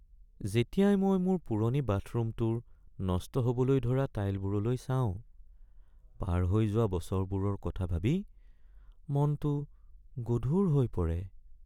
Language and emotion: Assamese, sad